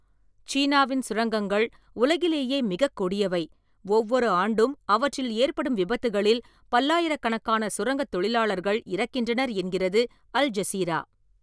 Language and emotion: Tamil, neutral